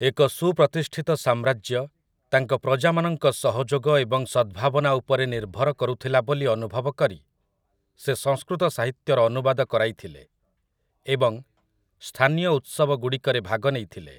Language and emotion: Odia, neutral